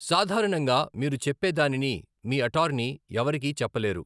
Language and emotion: Telugu, neutral